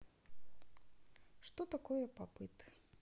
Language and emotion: Russian, neutral